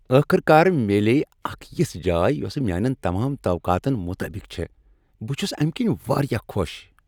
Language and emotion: Kashmiri, happy